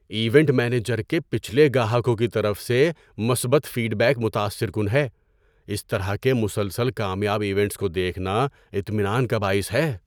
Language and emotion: Urdu, surprised